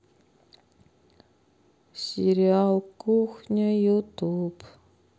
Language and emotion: Russian, sad